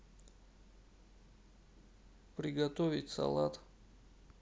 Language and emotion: Russian, neutral